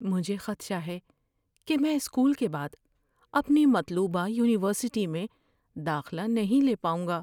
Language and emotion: Urdu, fearful